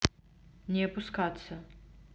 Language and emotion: Russian, neutral